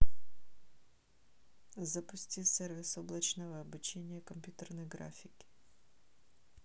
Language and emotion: Russian, neutral